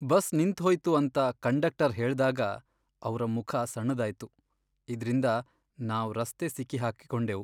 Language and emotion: Kannada, sad